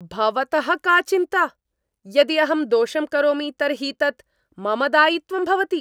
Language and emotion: Sanskrit, angry